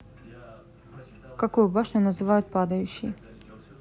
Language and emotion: Russian, neutral